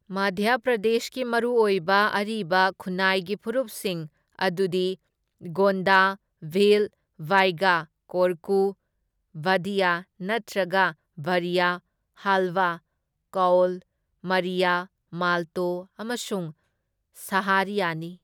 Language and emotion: Manipuri, neutral